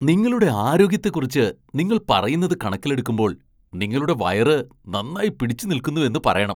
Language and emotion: Malayalam, surprised